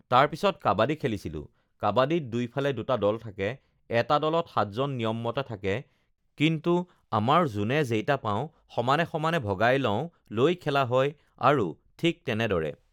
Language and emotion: Assamese, neutral